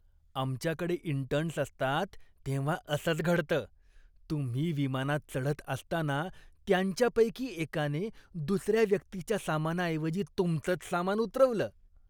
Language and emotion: Marathi, disgusted